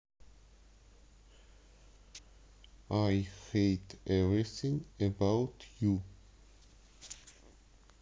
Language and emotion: Russian, neutral